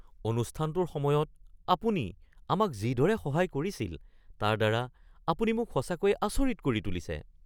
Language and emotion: Assamese, surprised